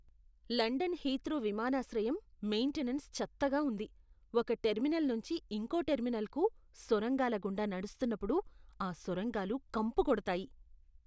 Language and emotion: Telugu, disgusted